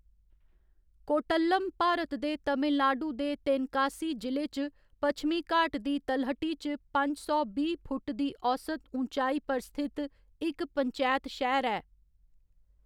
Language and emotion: Dogri, neutral